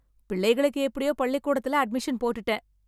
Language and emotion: Tamil, happy